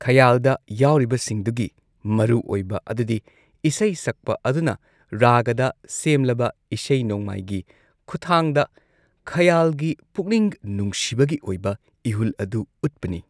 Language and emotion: Manipuri, neutral